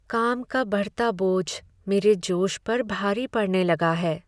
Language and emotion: Hindi, sad